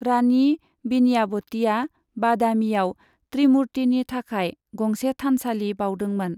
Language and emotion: Bodo, neutral